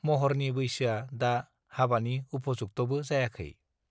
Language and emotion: Bodo, neutral